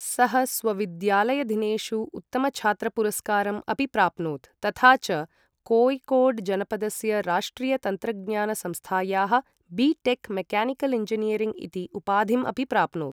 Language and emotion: Sanskrit, neutral